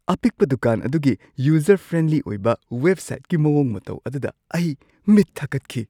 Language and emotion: Manipuri, surprised